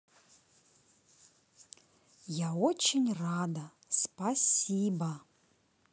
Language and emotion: Russian, positive